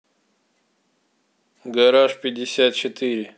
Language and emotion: Russian, neutral